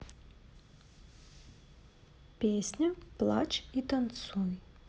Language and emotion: Russian, neutral